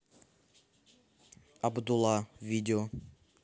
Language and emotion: Russian, neutral